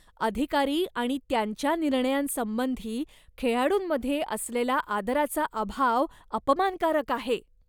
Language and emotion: Marathi, disgusted